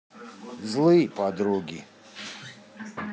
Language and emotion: Russian, neutral